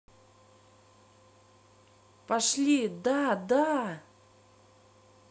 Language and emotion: Russian, positive